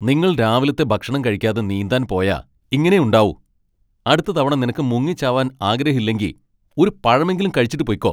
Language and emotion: Malayalam, angry